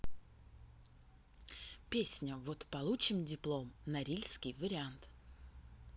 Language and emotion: Russian, neutral